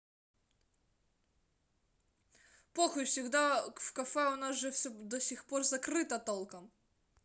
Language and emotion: Russian, angry